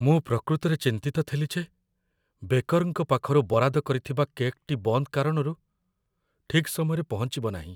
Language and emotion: Odia, fearful